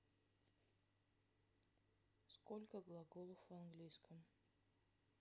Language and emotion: Russian, sad